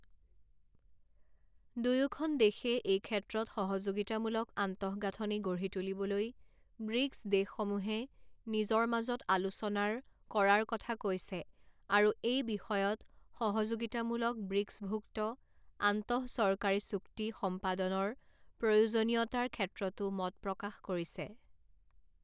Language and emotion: Assamese, neutral